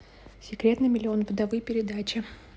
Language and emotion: Russian, neutral